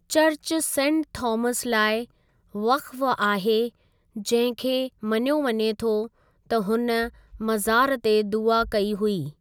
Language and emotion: Sindhi, neutral